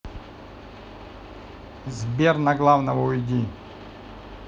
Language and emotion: Russian, neutral